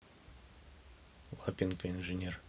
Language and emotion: Russian, neutral